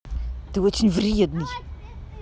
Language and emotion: Russian, angry